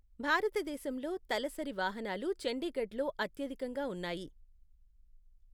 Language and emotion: Telugu, neutral